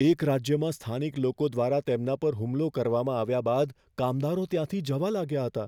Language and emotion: Gujarati, fearful